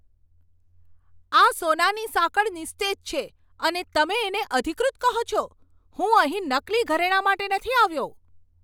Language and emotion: Gujarati, angry